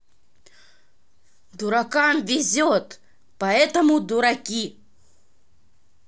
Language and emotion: Russian, neutral